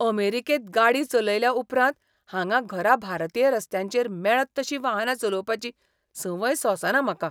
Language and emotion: Goan Konkani, disgusted